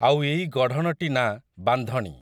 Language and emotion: Odia, neutral